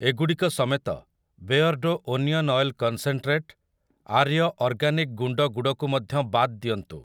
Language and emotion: Odia, neutral